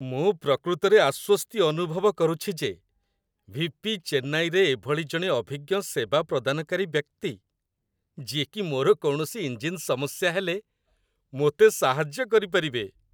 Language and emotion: Odia, happy